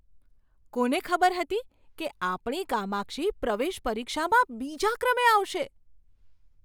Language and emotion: Gujarati, surprised